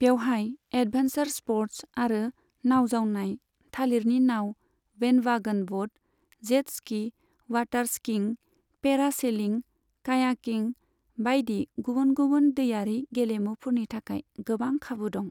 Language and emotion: Bodo, neutral